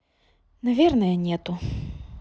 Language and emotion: Russian, sad